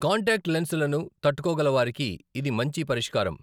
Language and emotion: Telugu, neutral